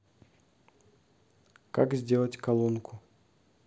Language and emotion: Russian, neutral